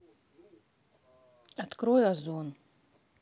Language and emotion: Russian, neutral